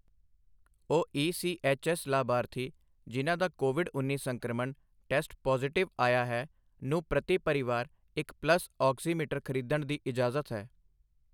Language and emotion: Punjabi, neutral